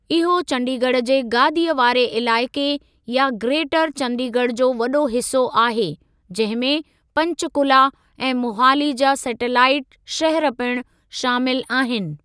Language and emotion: Sindhi, neutral